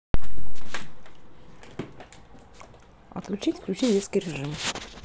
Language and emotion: Russian, neutral